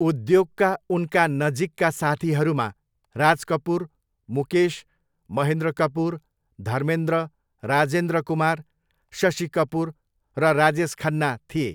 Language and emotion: Nepali, neutral